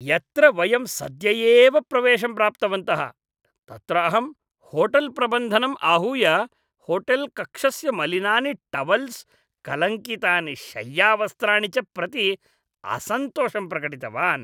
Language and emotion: Sanskrit, disgusted